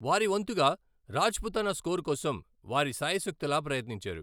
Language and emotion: Telugu, neutral